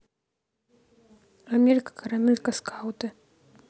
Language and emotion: Russian, neutral